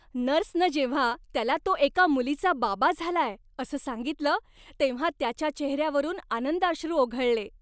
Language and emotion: Marathi, happy